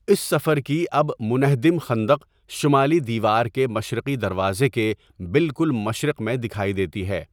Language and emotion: Urdu, neutral